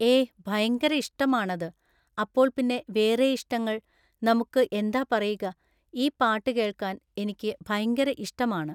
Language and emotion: Malayalam, neutral